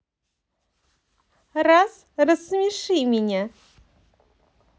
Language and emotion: Russian, positive